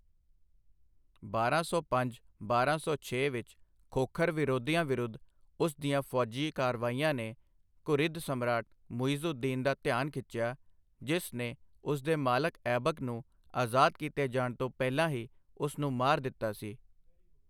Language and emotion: Punjabi, neutral